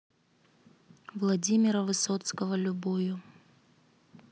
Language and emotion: Russian, neutral